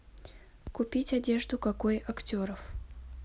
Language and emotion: Russian, neutral